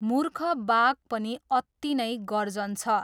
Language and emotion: Nepali, neutral